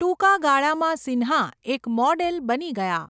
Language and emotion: Gujarati, neutral